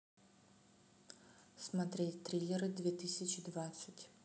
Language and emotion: Russian, neutral